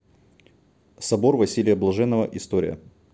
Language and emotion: Russian, neutral